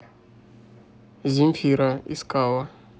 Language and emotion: Russian, neutral